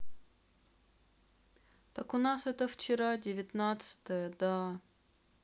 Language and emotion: Russian, sad